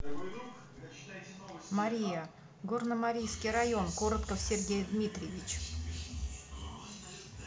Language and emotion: Russian, neutral